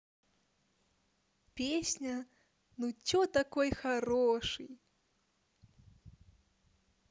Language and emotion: Russian, positive